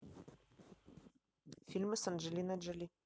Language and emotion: Russian, neutral